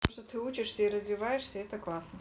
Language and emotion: Russian, neutral